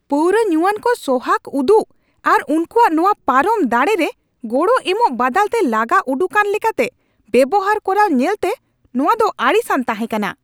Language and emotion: Santali, angry